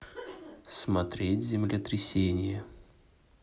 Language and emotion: Russian, neutral